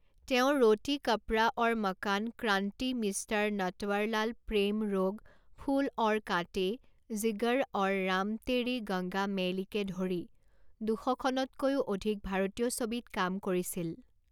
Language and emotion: Assamese, neutral